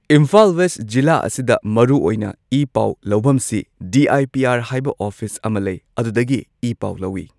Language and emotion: Manipuri, neutral